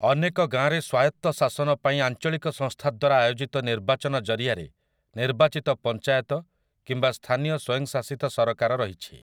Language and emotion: Odia, neutral